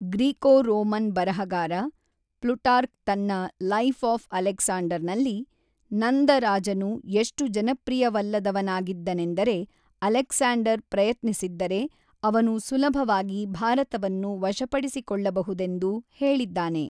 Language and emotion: Kannada, neutral